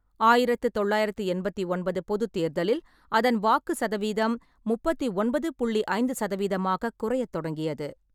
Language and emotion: Tamil, neutral